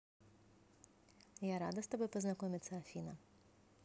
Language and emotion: Russian, positive